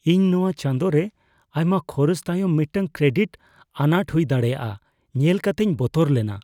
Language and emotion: Santali, fearful